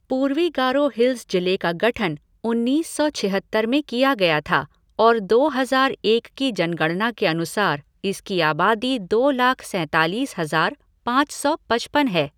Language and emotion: Hindi, neutral